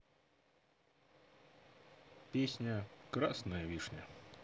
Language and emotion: Russian, neutral